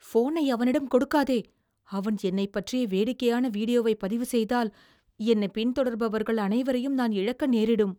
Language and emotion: Tamil, fearful